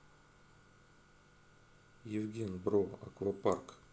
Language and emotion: Russian, neutral